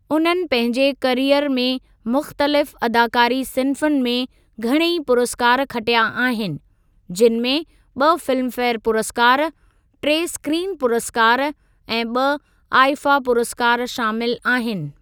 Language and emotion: Sindhi, neutral